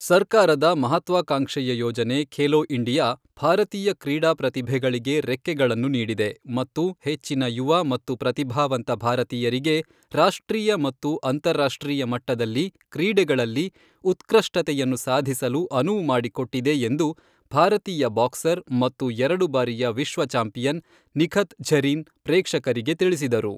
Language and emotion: Kannada, neutral